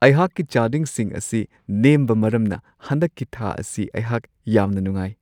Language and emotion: Manipuri, happy